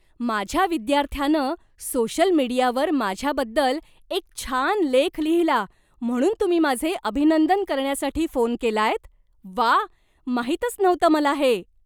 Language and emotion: Marathi, surprised